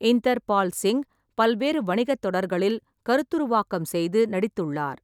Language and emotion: Tamil, neutral